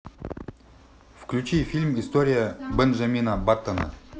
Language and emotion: Russian, neutral